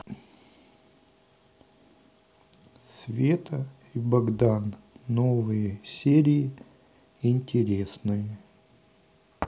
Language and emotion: Russian, neutral